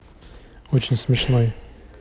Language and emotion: Russian, neutral